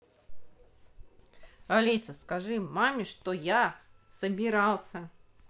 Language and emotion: Russian, neutral